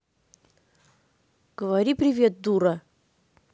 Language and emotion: Russian, angry